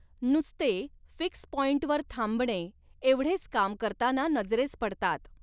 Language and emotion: Marathi, neutral